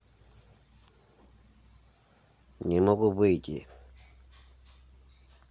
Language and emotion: Russian, neutral